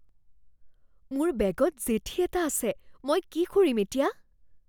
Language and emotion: Assamese, fearful